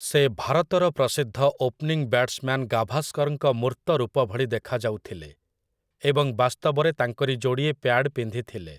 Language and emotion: Odia, neutral